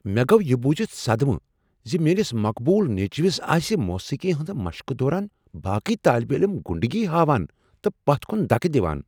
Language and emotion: Kashmiri, surprised